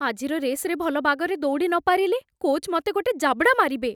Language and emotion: Odia, fearful